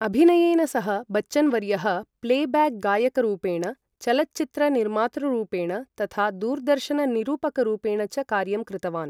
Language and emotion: Sanskrit, neutral